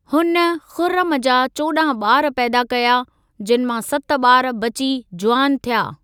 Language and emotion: Sindhi, neutral